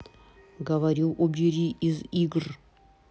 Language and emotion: Russian, angry